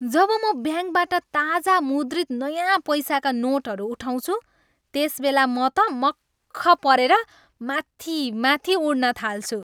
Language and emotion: Nepali, happy